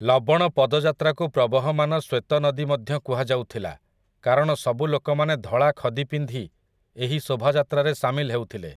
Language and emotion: Odia, neutral